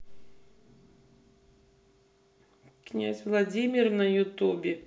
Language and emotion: Russian, neutral